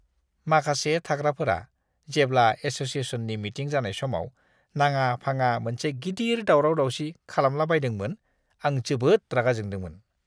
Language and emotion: Bodo, disgusted